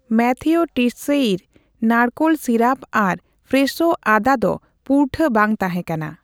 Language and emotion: Santali, neutral